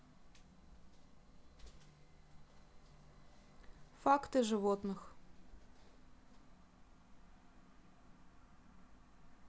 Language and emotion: Russian, neutral